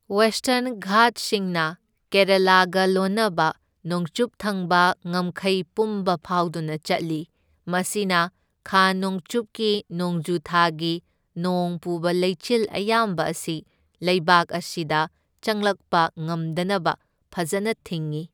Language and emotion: Manipuri, neutral